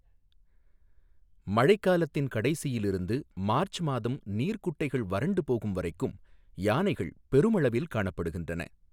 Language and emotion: Tamil, neutral